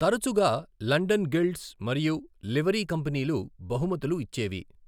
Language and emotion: Telugu, neutral